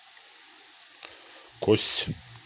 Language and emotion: Russian, neutral